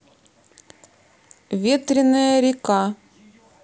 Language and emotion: Russian, neutral